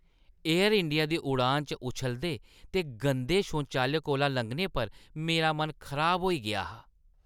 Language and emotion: Dogri, disgusted